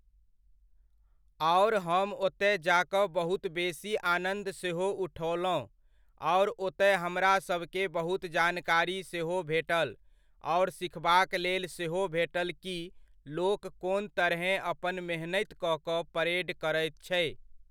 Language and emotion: Maithili, neutral